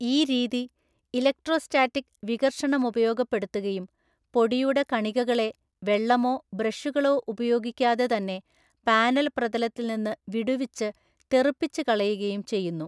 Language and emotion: Malayalam, neutral